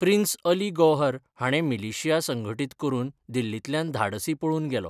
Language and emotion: Goan Konkani, neutral